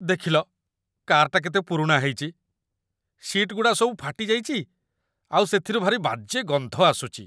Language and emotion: Odia, disgusted